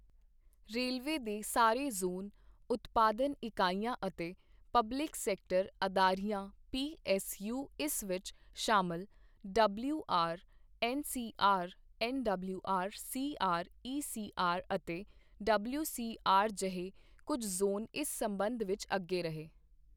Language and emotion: Punjabi, neutral